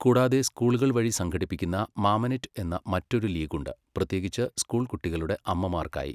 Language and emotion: Malayalam, neutral